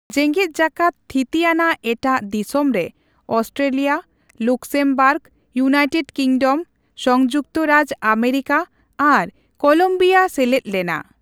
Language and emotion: Santali, neutral